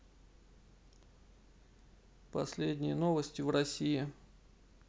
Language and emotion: Russian, neutral